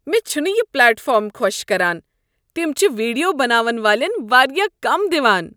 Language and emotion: Kashmiri, disgusted